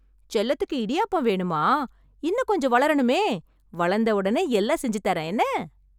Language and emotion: Tamil, happy